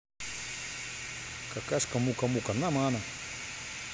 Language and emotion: Russian, neutral